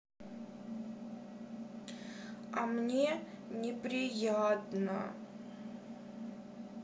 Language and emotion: Russian, sad